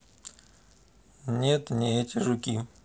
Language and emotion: Russian, neutral